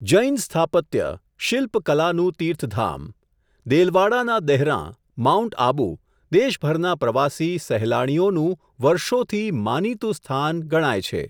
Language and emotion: Gujarati, neutral